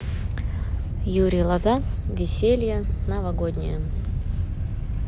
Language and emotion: Russian, neutral